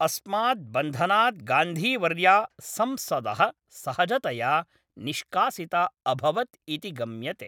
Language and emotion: Sanskrit, neutral